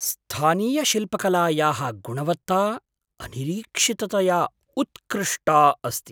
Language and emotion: Sanskrit, surprised